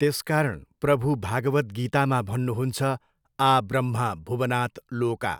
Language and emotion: Nepali, neutral